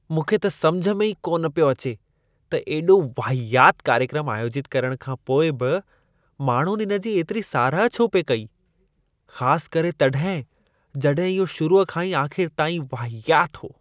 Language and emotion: Sindhi, disgusted